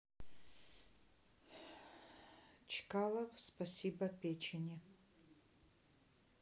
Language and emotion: Russian, neutral